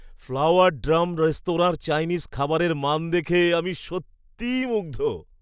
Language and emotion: Bengali, happy